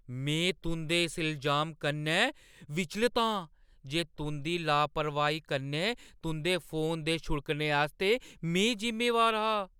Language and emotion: Dogri, surprised